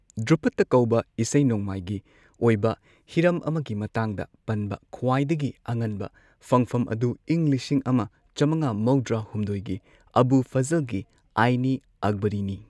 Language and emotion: Manipuri, neutral